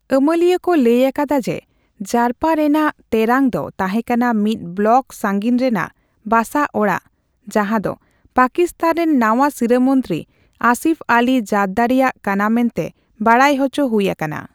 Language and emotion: Santali, neutral